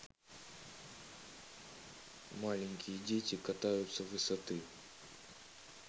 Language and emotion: Russian, neutral